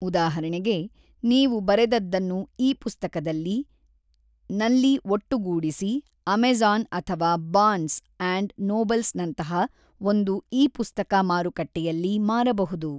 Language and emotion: Kannada, neutral